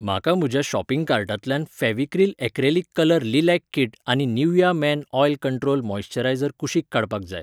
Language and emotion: Goan Konkani, neutral